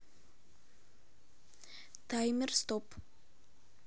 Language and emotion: Russian, neutral